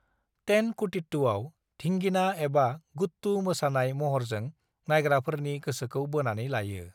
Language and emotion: Bodo, neutral